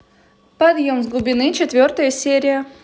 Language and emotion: Russian, positive